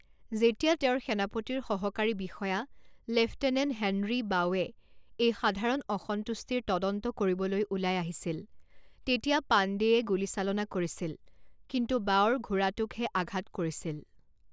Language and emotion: Assamese, neutral